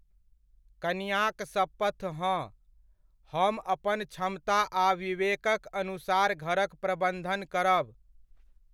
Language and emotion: Maithili, neutral